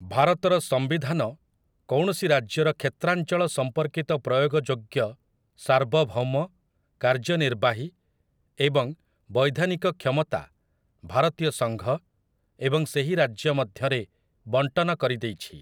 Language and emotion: Odia, neutral